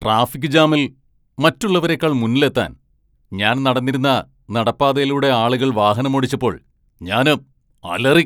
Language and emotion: Malayalam, angry